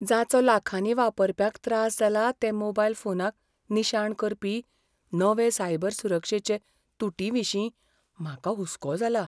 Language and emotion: Goan Konkani, fearful